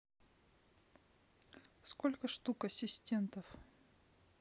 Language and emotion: Russian, sad